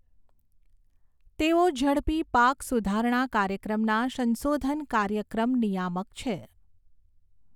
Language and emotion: Gujarati, neutral